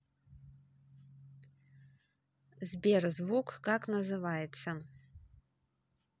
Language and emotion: Russian, neutral